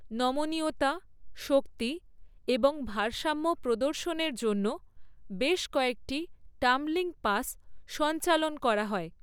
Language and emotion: Bengali, neutral